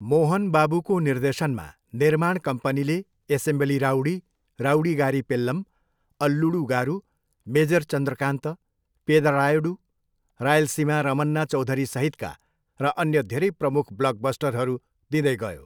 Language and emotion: Nepali, neutral